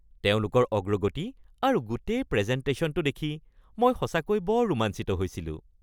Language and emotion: Assamese, happy